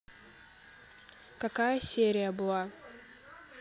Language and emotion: Russian, neutral